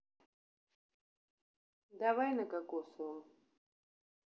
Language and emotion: Russian, neutral